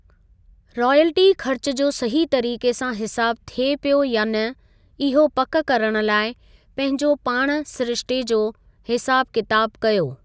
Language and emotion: Sindhi, neutral